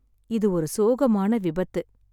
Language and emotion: Tamil, sad